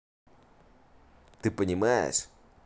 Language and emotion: Russian, neutral